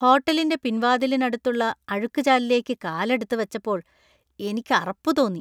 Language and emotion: Malayalam, disgusted